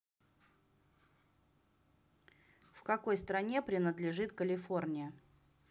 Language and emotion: Russian, neutral